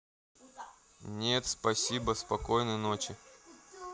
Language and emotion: Russian, neutral